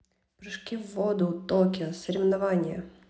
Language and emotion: Russian, neutral